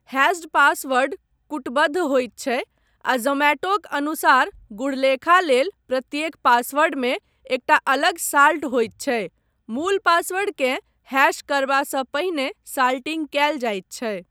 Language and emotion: Maithili, neutral